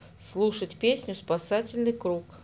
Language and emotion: Russian, neutral